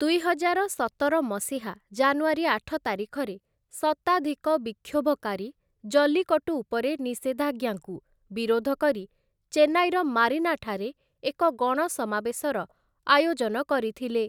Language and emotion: Odia, neutral